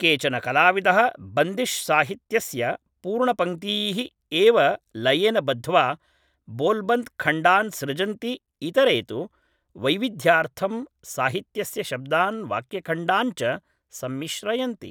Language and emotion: Sanskrit, neutral